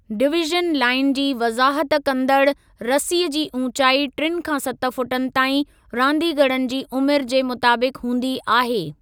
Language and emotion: Sindhi, neutral